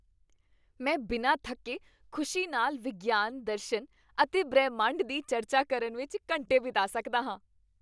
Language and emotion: Punjabi, happy